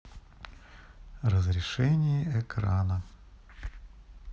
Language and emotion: Russian, neutral